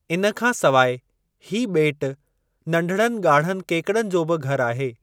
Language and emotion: Sindhi, neutral